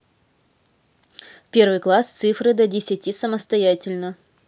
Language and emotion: Russian, neutral